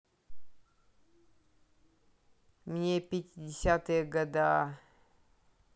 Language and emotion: Russian, neutral